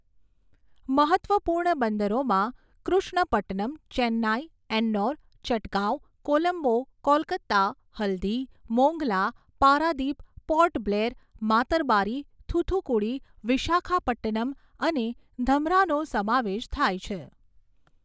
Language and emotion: Gujarati, neutral